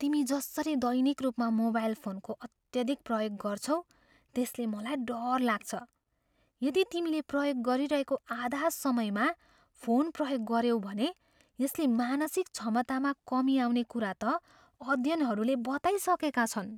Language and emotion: Nepali, fearful